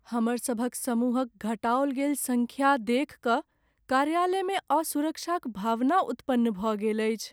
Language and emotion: Maithili, sad